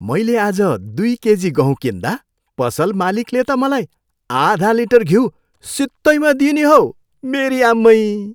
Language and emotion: Nepali, happy